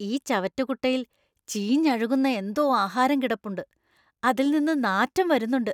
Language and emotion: Malayalam, disgusted